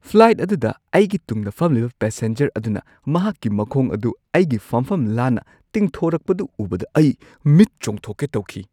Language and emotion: Manipuri, surprised